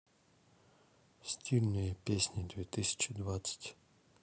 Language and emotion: Russian, neutral